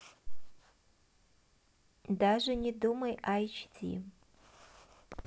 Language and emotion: Russian, neutral